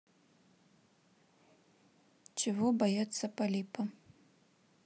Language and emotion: Russian, neutral